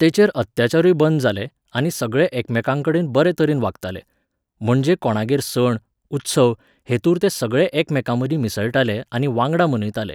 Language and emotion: Goan Konkani, neutral